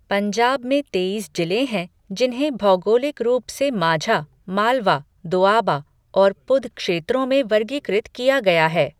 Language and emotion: Hindi, neutral